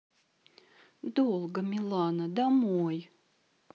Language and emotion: Russian, sad